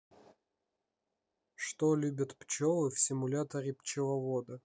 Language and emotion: Russian, neutral